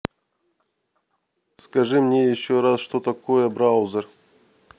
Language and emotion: Russian, neutral